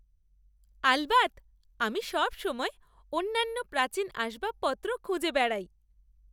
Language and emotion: Bengali, happy